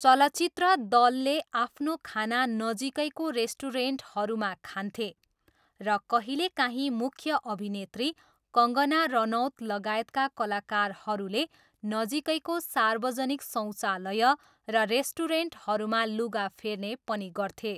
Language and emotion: Nepali, neutral